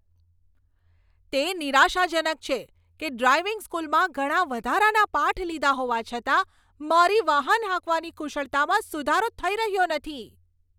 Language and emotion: Gujarati, angry